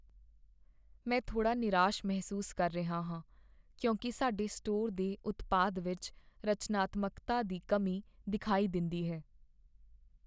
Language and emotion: Punjabi, sad